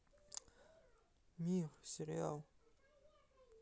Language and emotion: Russian, sad